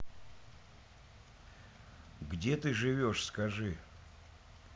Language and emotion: Russian, neutral